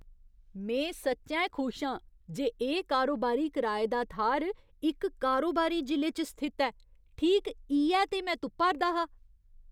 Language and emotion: Dogri, surprised